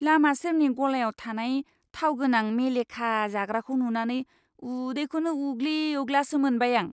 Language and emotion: Bodo, disgusted